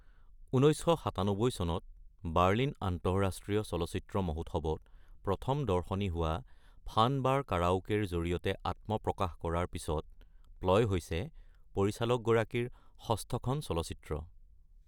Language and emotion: Assamese, neutral